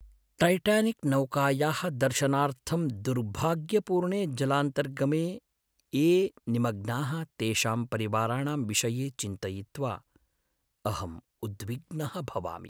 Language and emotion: Sanskrit, sad